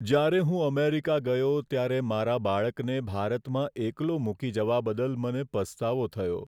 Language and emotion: Gujarati, sad